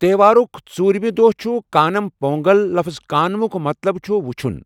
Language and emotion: Kashmiri, neutral